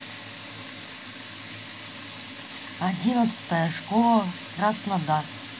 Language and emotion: Russian, neutral